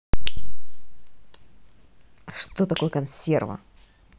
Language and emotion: Russian, neutral